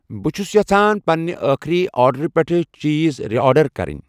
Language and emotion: Kashmiri, neutral